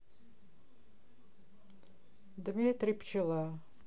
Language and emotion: Russian, neutral